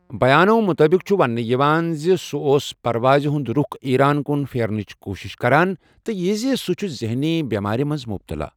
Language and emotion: Kashmiri, neutral